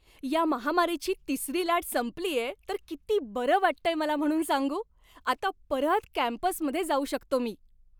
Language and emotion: Marathi, happy